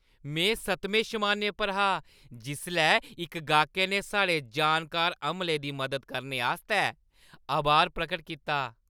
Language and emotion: Dogri, happy